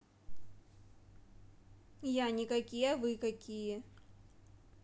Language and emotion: Russian, neutral